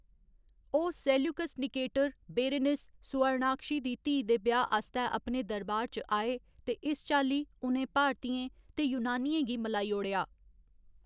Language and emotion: Dogri, neutral